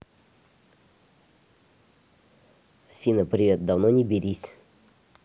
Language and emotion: Russian, neutral